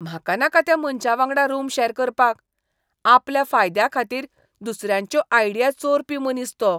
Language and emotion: Goan Konkani, disgusted